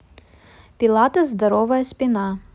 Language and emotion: Russian, neutral